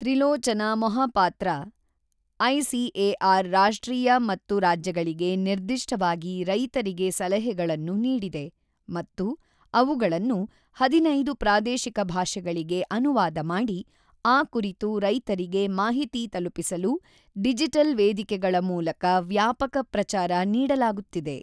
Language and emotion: Kannada, neutral